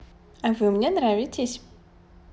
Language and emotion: Russian, positive